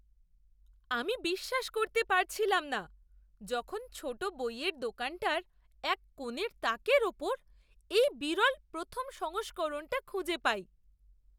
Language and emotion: Bengali, surprised